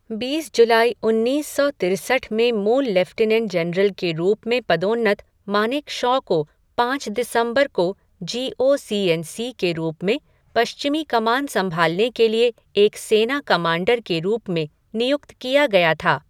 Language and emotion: Hindi, neutral